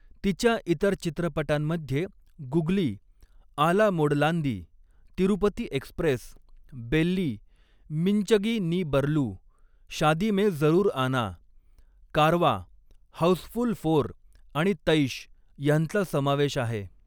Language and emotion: Marathi, neutral